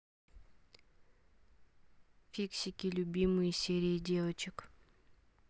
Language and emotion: Russian, neutral